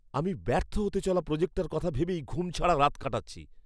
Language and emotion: Bengali, fearful